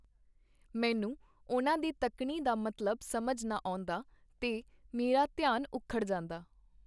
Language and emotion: Punjabi, neutral